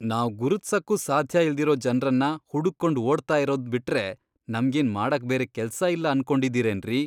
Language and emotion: Kannada, disgusted